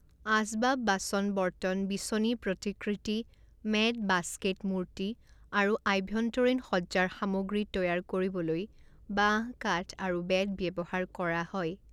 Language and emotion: Assamese, neutral